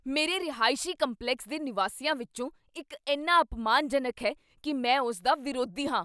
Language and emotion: Punjabi, angry